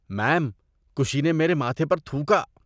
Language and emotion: Urdu, disgusted